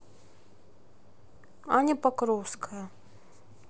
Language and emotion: Russian, neutral